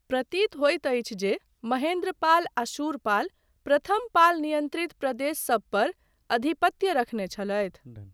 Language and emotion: Maithili, neutral